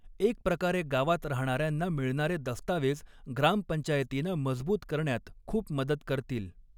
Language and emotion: Marathi, neutral